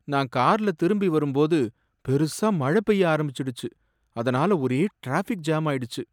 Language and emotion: Tamil, sad